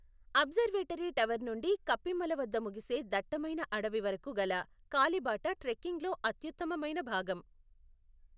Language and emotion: Telugu, neutral